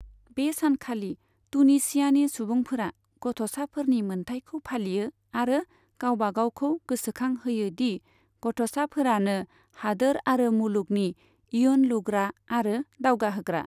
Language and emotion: Bodo, neutral